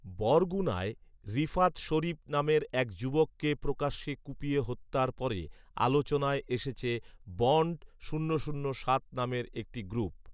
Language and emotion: Bengali, neutral